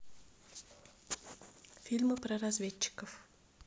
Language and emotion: Russian, neutral